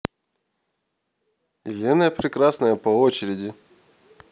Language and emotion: Russian, neutral